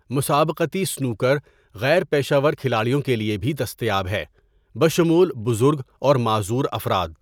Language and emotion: Urdu, neutral